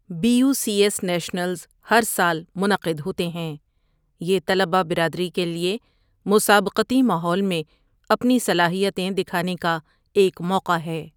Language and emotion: Urdu, neutral